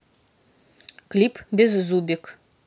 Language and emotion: Russian, neutral